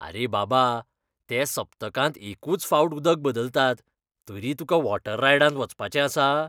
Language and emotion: Goan Konkani, disgusted